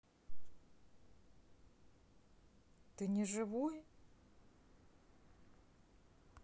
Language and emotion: Russian, neutral